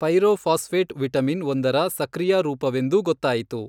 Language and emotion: Kannada, neutral